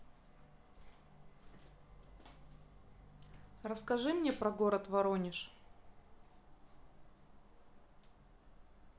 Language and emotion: Russian, neutral